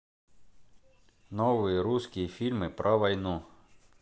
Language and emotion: Russian, neutral